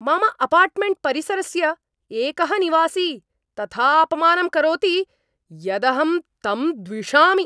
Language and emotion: Sanskrit, angry